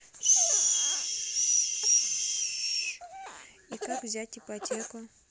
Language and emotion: Russian, neutral